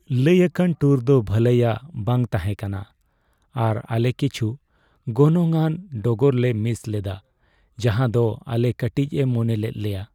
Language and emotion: Santali, sad